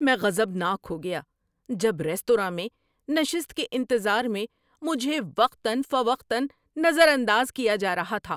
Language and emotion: Urdu, angry